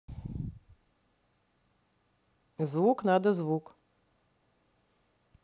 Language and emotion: Russian, neutral